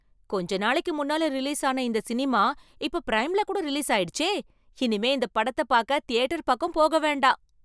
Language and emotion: Tamil, surprised